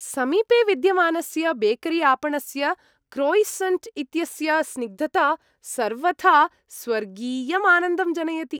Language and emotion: Sanskrit, happy